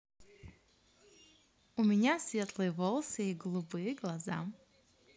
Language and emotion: Russian, positive